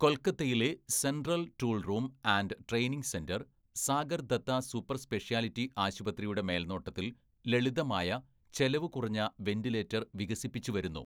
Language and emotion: Malayalam, neutral